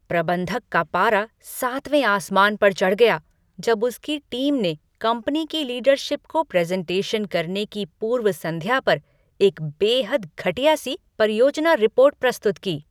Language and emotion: Hindi, angry